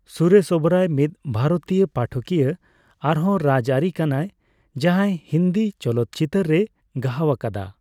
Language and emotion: Santali, neutral